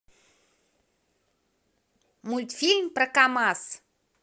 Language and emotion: Russian, positive